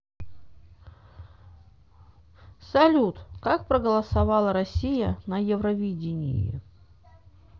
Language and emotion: Russian, neutral